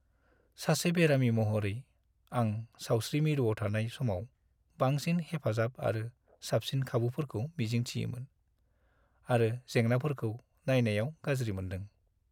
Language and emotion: Bodo, sad